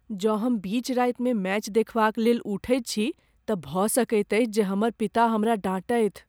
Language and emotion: Maithili, fearful